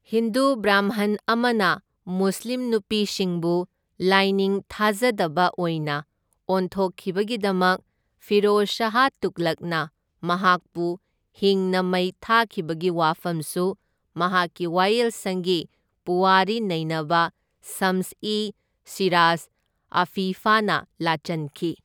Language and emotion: Manipuri, neutral